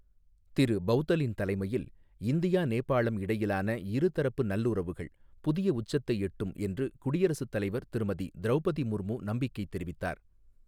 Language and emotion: Tamil, neutral